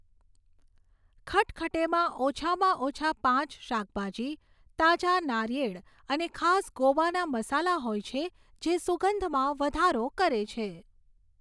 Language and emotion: Gujarati, neutral